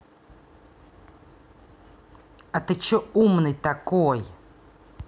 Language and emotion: Russian, angry